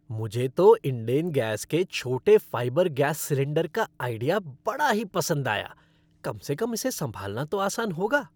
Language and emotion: Hindi, happy